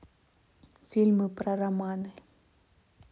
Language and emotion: Russian, neutral